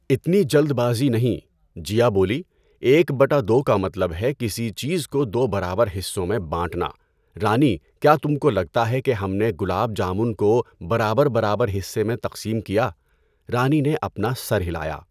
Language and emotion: Urdu, neutral